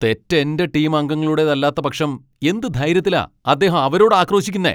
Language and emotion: Malayalam, angry